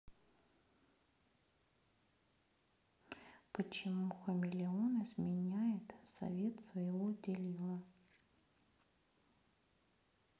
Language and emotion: Russian, neutral